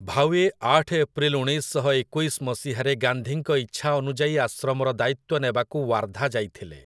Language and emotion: Odia, neutral